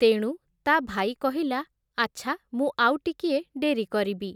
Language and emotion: Odia, neutral